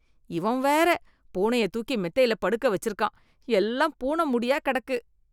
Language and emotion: Tamil, disgusted